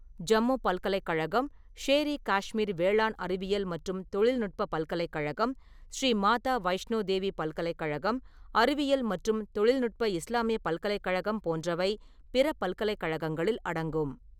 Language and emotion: Tamil, neutral